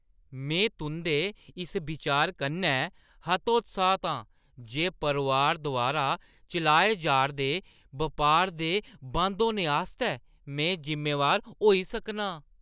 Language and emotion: Dogri, disgusted